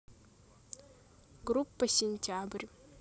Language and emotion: Russian, neutral